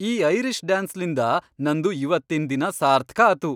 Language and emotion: Kannada, happy